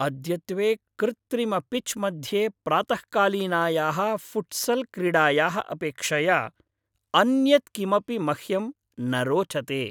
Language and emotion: Sanskrit, happy